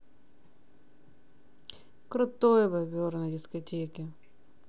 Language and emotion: Russian, positive